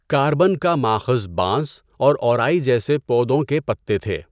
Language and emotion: Urdu, neutral